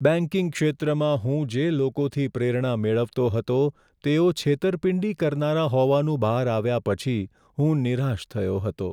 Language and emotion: Gujarati, sad